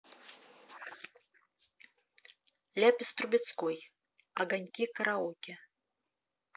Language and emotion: Russian, neutral